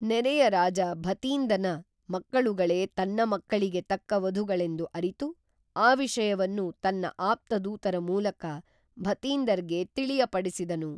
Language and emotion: Kannada, neutral